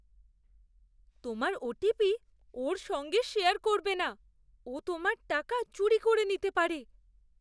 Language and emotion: Bengali, fearful